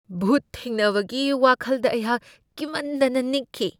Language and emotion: Manipuri, fearful